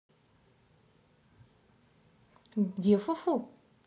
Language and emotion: Russian, positive